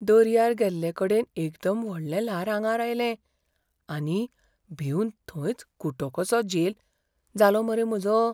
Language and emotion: Goan Konkani, fearful